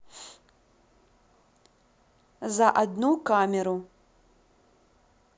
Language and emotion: Russian, neutral